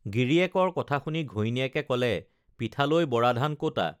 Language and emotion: Assamese, neutral